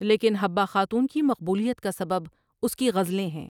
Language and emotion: Urdu, neutral